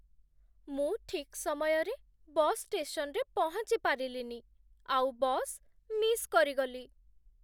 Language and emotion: Odia, sad